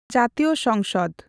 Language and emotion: Santali, neutral